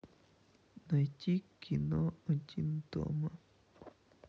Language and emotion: Russian, sad